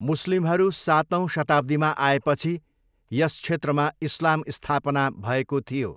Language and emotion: Nepali, neutral